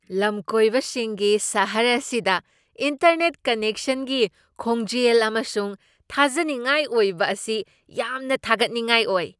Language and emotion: Manipuri, surprised